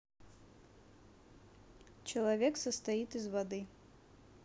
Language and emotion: Russian, neutral